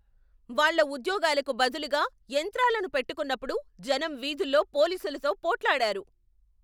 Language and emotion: Telugu, angry